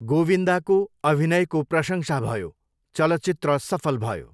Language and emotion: Nepali, neutral